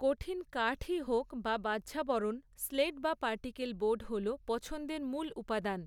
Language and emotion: Bengali, neutral